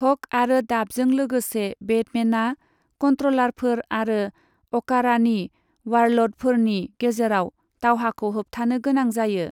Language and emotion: Bodo, neutral